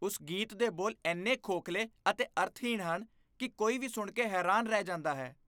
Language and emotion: Punjabi, disgusted